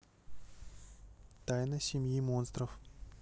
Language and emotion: Russian, neutral